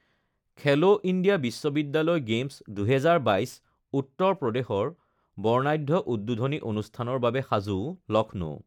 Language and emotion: Assamese, neutral